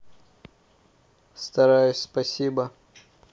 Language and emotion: Russian, neutral